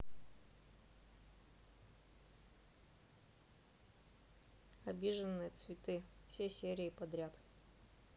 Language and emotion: Russian, neutral